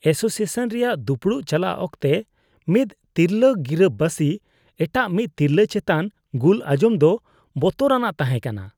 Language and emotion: Santali, disgusted